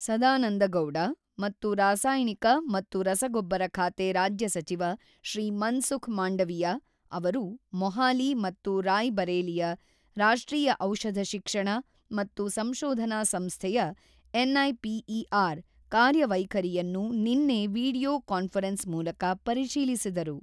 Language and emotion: Kannada, neutral